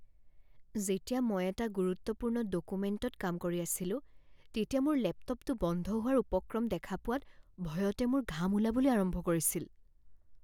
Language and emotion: Assamese, fearful